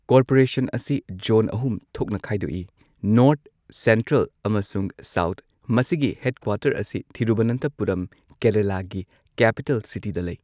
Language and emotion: Manipuri, neutral